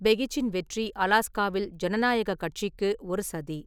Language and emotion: Tamil, neutral